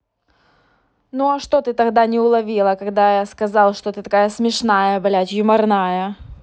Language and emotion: Russian, angry